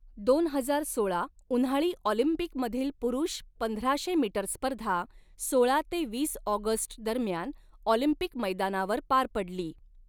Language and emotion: Marathi, neutral